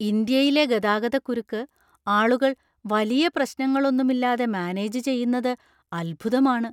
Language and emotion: Malayalam, surprised